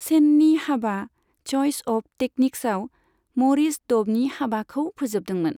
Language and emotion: Bodo, neutral